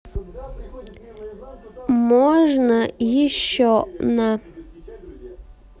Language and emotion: Russian, neutral